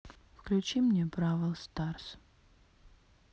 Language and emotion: Russian, sad